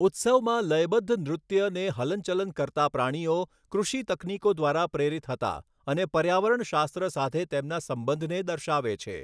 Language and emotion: Gujarati, neutral